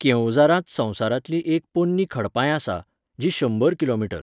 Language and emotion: Goan Konkani, neutral